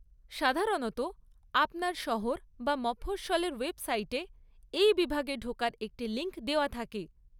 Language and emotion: Bengali, neutral